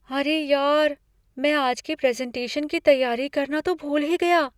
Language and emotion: Hindi, fearful